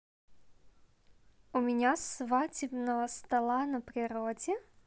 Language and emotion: Russian, positive